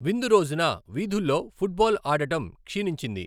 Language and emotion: Telugu, neutral